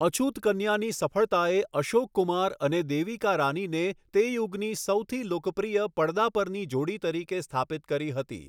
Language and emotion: Gujarati, neutral